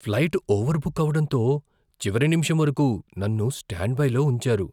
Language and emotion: Telugu, fearful